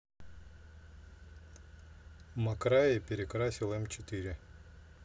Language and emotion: Russian, neutral